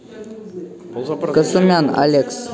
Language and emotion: Russian, neutral